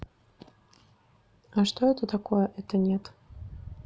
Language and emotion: Russian, neutral